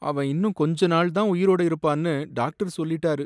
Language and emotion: Tamil, sad